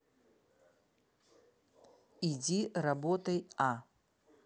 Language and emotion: Russian, neutral